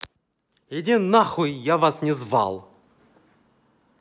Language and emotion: Russian, angry